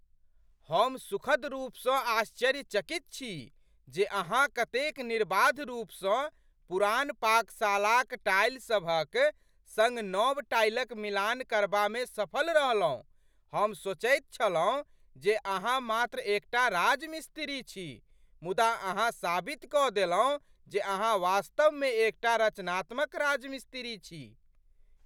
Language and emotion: Maithili, surprised